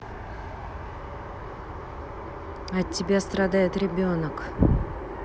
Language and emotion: Russian, angry